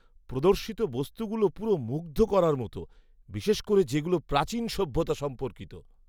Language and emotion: Bengali, surprised